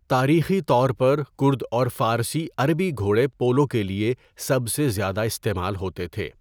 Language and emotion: Urdu, neutral